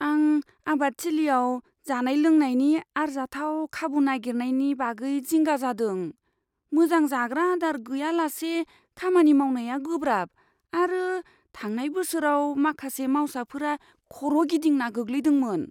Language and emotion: Bodo, fearful